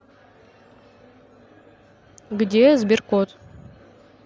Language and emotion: Russian, neutral